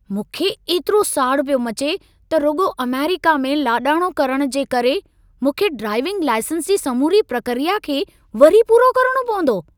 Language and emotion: Sindhi, angry